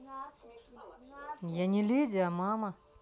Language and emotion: Russian, neutral